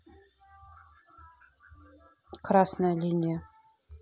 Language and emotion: Russian, neutral